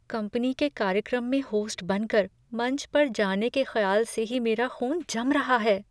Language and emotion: Hindi, fearful